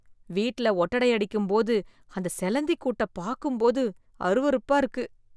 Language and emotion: Tamil, disgusted